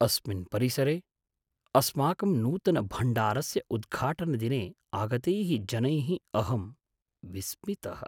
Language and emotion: Sanskrit, surprised